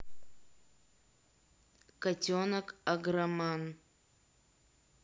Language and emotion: Russian, neutral